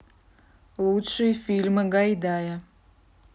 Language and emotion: Russian, neutral